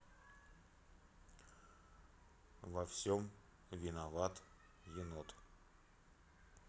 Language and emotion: Russian, neutral